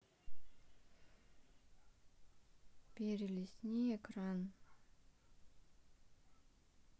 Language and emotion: Russian, neutral